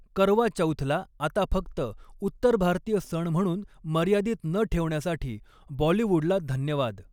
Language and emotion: Marathi, neutral